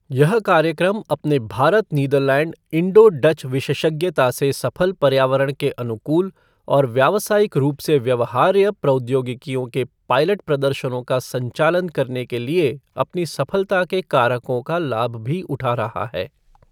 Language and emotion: Hindi, neutral